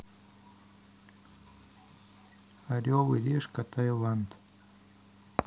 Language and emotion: Russian, neutral